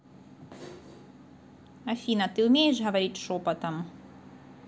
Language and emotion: Russian, neutral